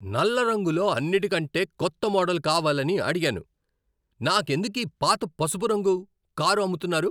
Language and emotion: Telugu, angry